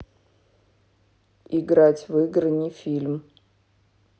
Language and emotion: Russian, neutral